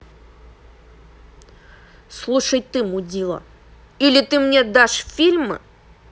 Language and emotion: Russian, angry